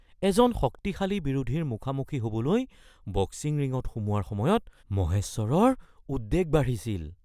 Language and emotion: Assamese, fearful